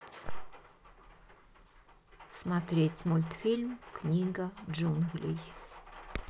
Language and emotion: Russian, neutral